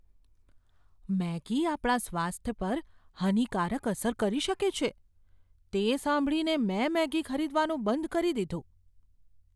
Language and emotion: Gujarati, fearful